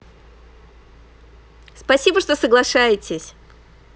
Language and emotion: Russian, positive